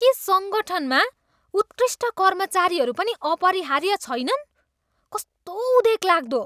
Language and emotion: Nepali, disgusted